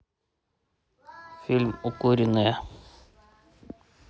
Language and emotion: Russian, neutral